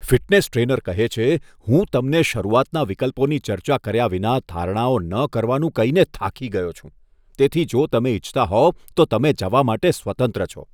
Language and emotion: Gujarati, disgusted